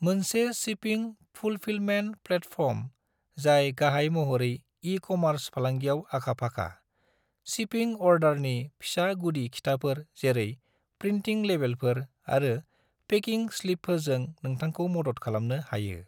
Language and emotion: Bodo, neutral